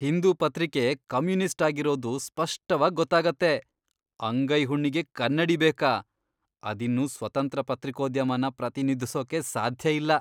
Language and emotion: Kannada, disgusted